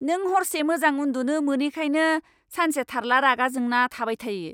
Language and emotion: Bodo, angry